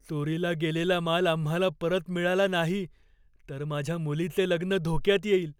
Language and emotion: Marathi, fearful